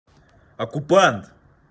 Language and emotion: Russian, neutral